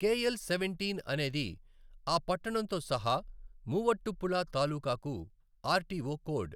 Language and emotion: Telugu, neutral